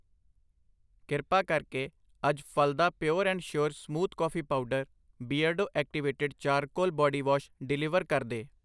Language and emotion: Punjabi, neutral